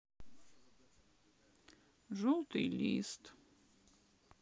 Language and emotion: Russian, sad